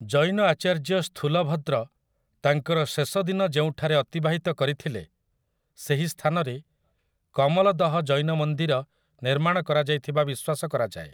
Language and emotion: Odia, neutral